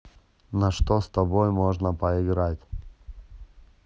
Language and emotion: Russian, neutral